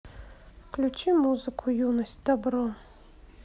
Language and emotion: Russian, sad